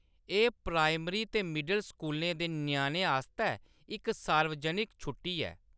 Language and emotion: Dogri, neutral